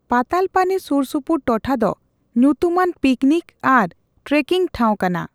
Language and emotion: Santali, neutral